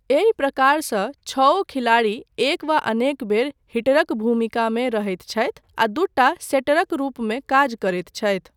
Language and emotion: Maithili, neutral